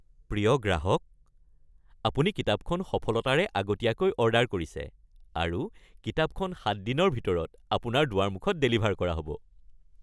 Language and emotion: Assamese, happy